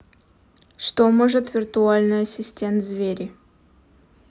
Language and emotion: Russian, neutral